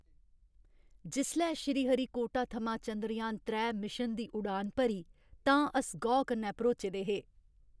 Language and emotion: Dogri, happy